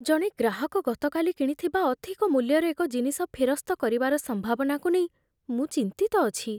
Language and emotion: Odia, fearful